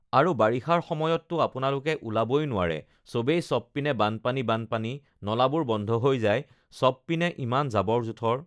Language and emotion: Assamese, neutral